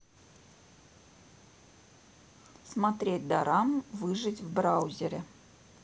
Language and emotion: Russian, neutral